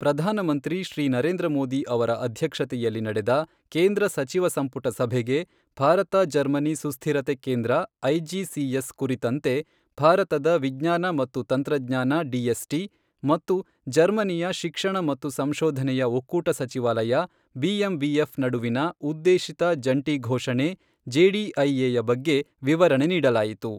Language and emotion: Kannada, neutral